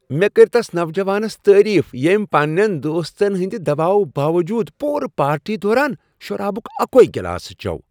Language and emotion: Kashmiri, happy